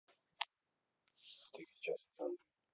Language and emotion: Russian, neutral